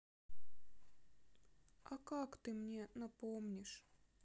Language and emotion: Russian, sad